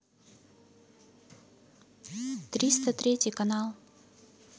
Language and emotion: Russian, neutral